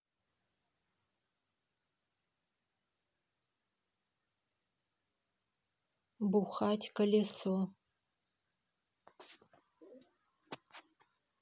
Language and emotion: Russian, neutral